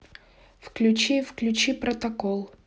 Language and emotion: Russian, neutral